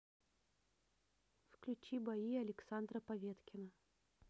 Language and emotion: Russian, neutral